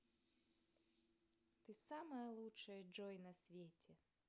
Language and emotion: Russian, positive